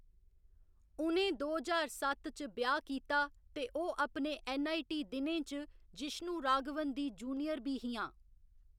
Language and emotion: Dogri, neutral